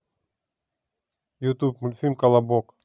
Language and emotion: Russian, neutral